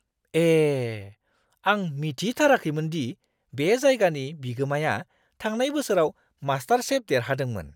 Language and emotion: Bodo, surprised